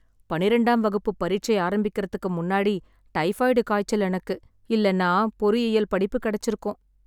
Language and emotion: Tamil, sad